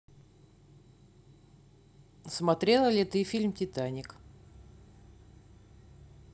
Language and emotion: Russian, neutral